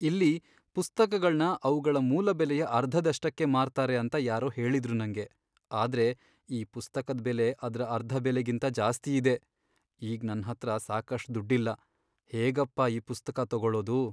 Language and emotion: Kannada, sad